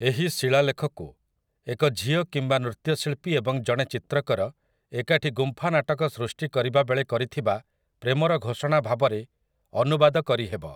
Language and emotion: Odia, neutral